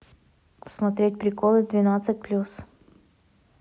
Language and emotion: Russian, neutral